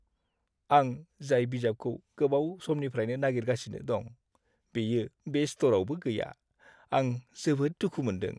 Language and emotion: Bodo, sad